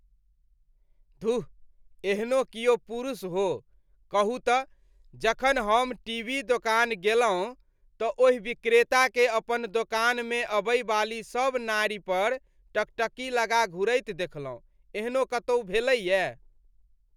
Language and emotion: Maithili, disgusted